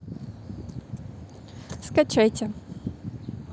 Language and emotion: Russian, neutral